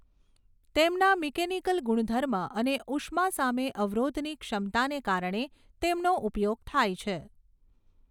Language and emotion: Gujarati, neutral